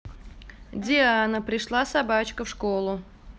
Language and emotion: Russian, neutral